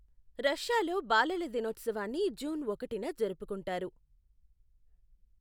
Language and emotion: Telugu, neutral